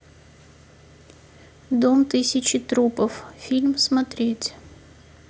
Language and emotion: Russian, sad